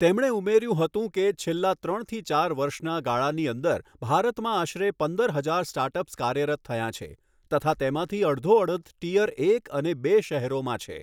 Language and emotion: Gujarati, neutral